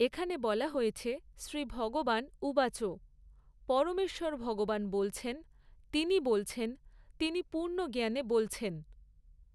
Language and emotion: Bengali, neutral